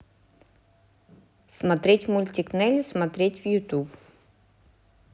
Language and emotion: Russian, neutral